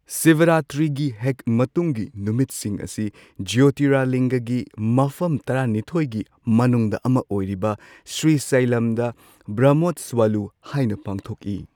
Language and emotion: Manipuri, neutral